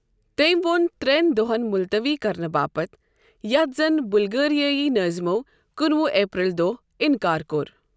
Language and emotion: Kashmiri, neutral